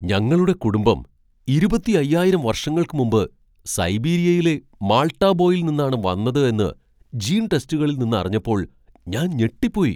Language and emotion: Malayalam, surprised